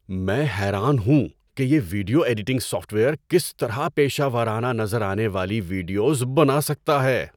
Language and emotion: Urdu, surprised